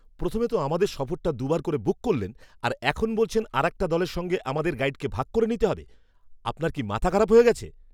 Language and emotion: Bengali, angry